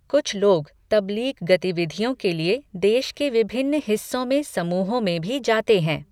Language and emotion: Hindi, neutral